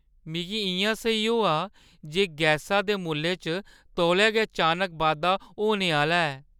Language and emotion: Dogri, fearful